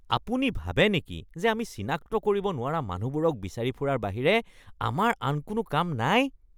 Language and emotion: Assamese, disgusted